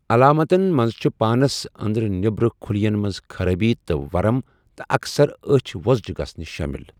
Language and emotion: Kashmiri, neutral